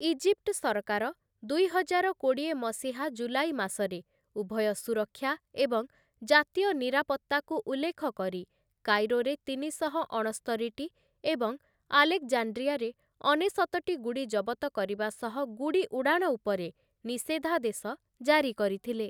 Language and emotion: Odia, neutral